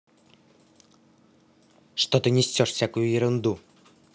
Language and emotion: Russian, angry